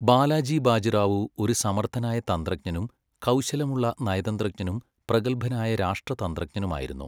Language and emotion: Malayalam, neutral